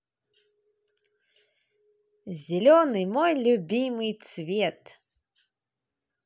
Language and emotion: Russian, positive